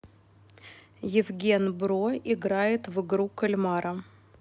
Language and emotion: Russian, neutral